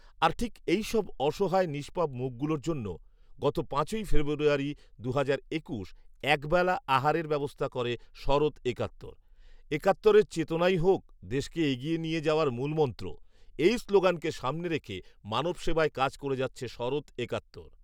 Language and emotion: Bengali, neutral